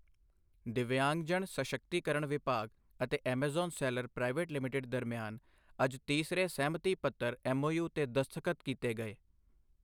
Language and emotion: Punjabi, neutral